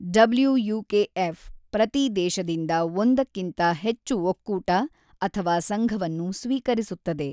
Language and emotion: Kannada, neutral